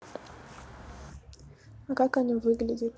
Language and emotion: Russian, neutral